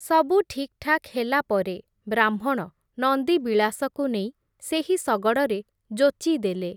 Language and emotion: Odia, neutral